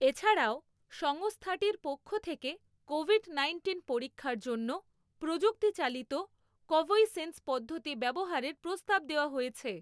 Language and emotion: Bengali, neutral